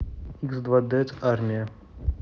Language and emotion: Russian, neutral